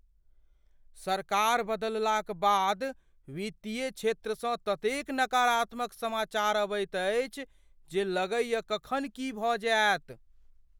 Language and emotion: Maithili, fearful